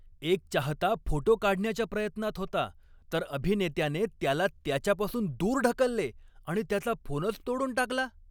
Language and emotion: Marathi, angry